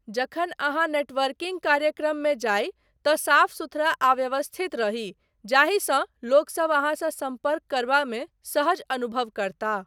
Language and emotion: Maithili, neutral